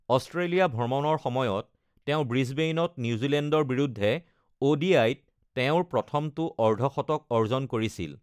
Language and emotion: Assamese, neutral